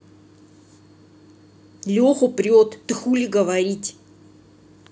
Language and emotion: Russian, angry